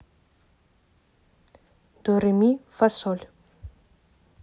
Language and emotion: Russian, neutral